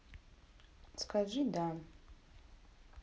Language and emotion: Russian, neutral